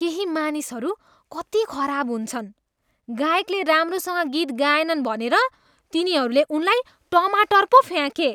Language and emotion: Nepali, disgusted